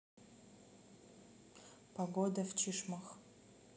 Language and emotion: Russian, neutral